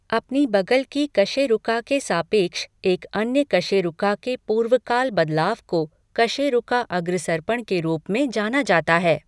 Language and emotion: Hindi, neutral